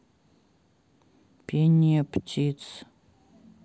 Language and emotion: Russian, neutral